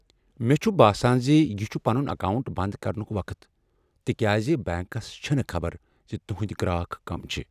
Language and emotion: Kashmiri, sad